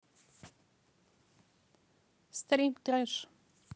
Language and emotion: Russian, neutral